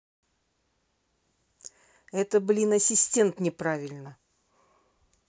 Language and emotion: Russian, angry